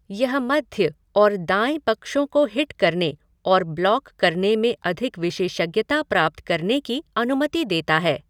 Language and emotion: Hindi, neutral